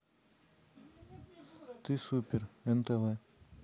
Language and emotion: Russian, neutral